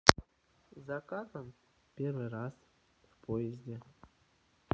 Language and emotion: Russian, neutral